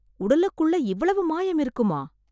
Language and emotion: Tamil, surprised